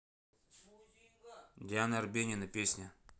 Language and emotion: Russian, neutral